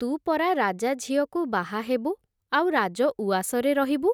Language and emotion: Odia, neutral